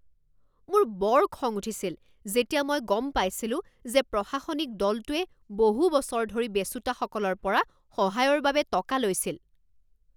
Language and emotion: Assamese, angry